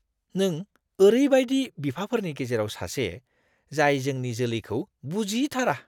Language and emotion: Bodo, disgusted